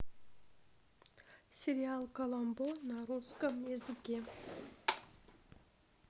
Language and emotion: Russian, neutral